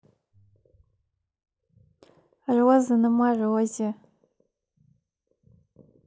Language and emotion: Russian, positive